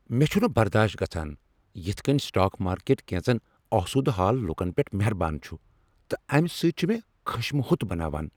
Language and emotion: Kashmiri, angry